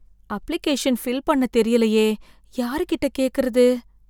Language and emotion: Tamil, fearful